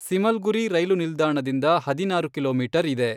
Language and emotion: Kannada, neutral